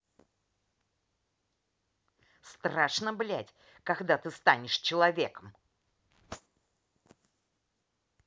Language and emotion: Russian, angry